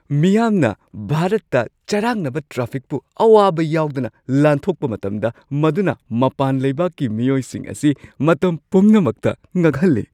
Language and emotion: Manipuri, surprised